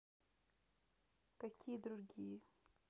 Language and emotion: Russian, neutral